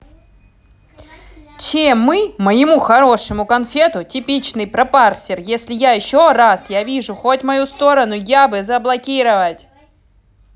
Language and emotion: Russian, angry